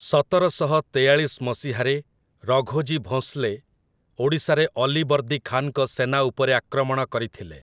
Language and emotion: Odia, neutral